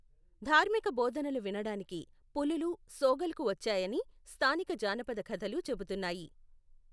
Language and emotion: Telugu, neutral